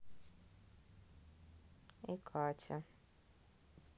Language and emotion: Russian, neutral